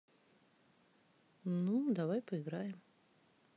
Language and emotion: Russian, neutral